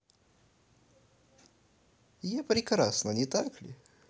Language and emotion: Russian, positive